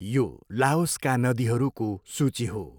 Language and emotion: Nepali, neutral